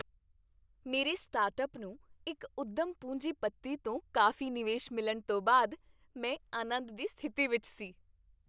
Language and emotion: Punjabi, happy